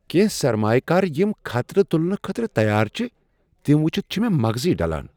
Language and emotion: Kashmiri, surprised